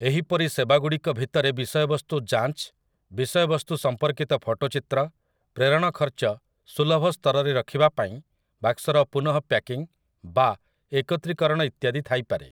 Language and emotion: Odia, neutral